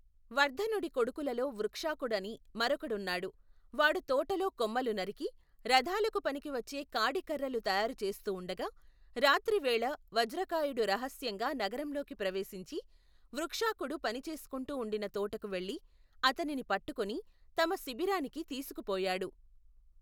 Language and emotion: Telugu, neutral